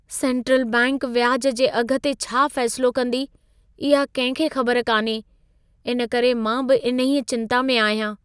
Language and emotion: Sindhi, fearful